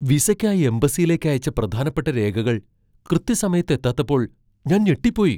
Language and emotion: Malayalam, surprised